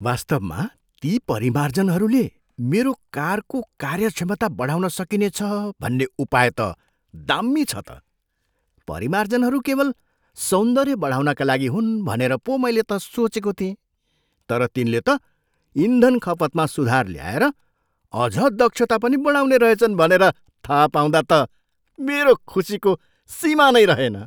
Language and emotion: Nepali, surprised